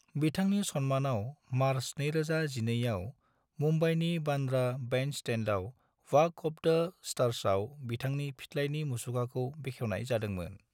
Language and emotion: Bodo, neutral